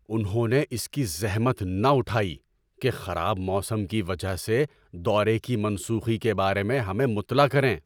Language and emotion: Urdu, angry